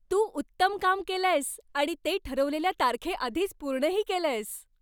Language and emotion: Marathi, happy